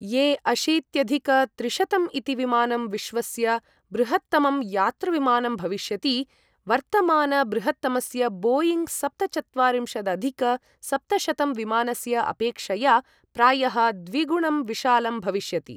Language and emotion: Sanskrit, neutral